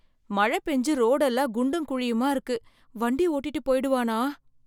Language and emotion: Tamil, fearful